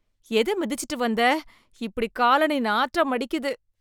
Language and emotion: Tamil, disgusted